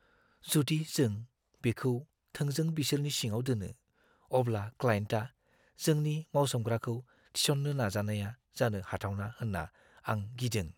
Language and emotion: Bodo, fearful